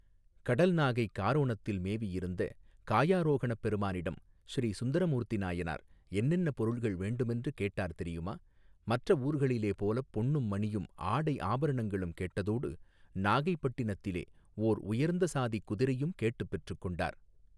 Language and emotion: Tamil, neutral